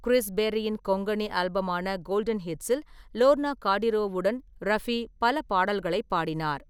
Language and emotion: Tamil, neutral